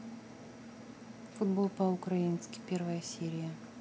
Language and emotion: Russian, neutral